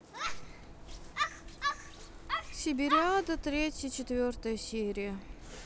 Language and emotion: Russian, sad